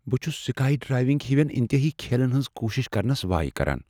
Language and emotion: Kashmiri, fearful